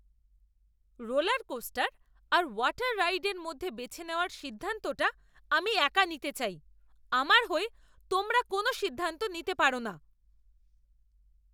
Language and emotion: Bengali, angry